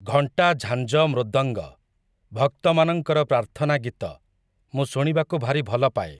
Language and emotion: Odia, neutral